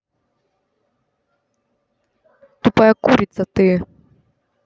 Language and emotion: Russian, angry